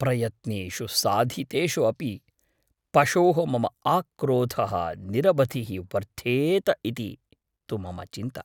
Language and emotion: Sanskrit, fearful